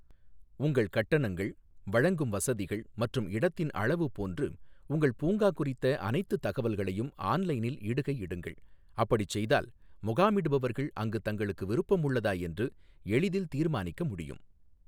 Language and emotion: Tamil, neutral